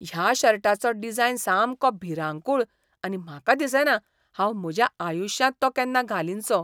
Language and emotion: Goan Konkani, disgusted